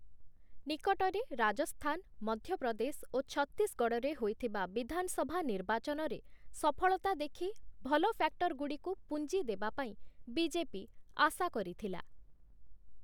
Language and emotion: Odia, neutral